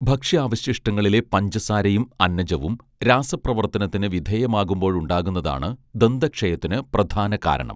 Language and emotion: Malayalam, neutral